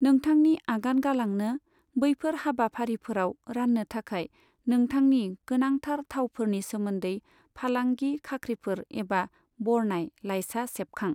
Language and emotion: Bodo, neutral